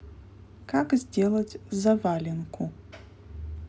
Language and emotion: Russian, neutral